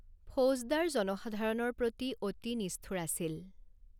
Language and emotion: Assamese, neutral